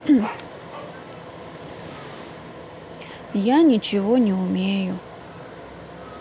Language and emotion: Russian, sad